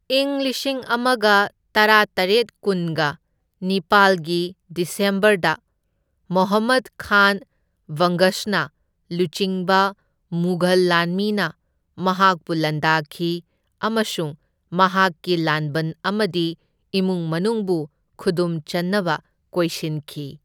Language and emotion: Manipuri, neutral